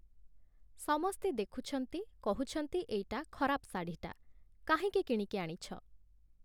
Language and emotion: Odia, neutral